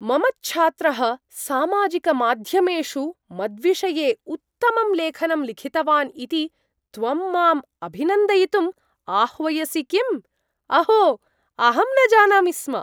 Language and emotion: Sanskrit, surprised